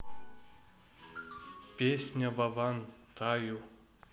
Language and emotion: Russian, neutral